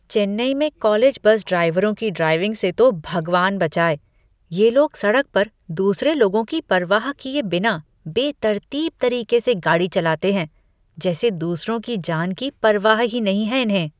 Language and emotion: Hindi, disgusted